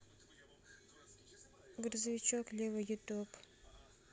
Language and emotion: Russian, neutral